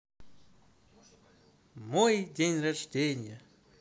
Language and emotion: Russian, positive